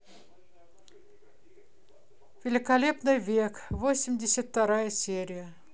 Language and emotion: Russian, neutral